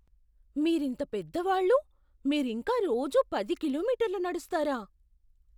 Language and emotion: Telugu, surprised